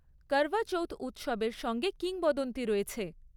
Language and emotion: Bengali, neutral